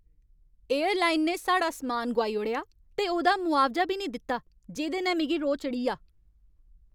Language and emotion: Dogri, angry